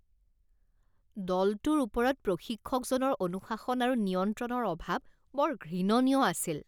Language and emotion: Assamese, disgusted